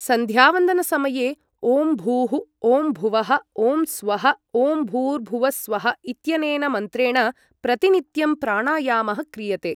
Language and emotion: Sanskrit, neutral